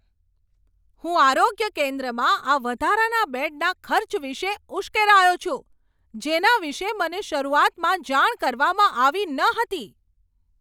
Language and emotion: Gujarati, angry